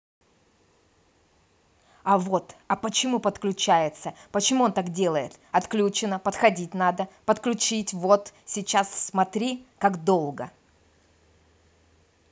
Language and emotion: Russian, angry